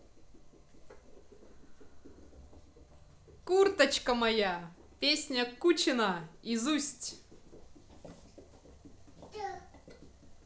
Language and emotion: Russian, positive